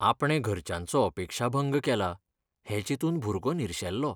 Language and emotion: Goan Konkani, sad